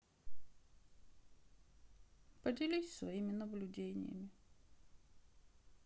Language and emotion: Russian, sad